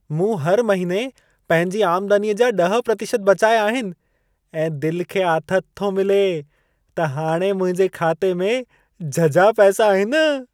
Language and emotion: Sindhi, happy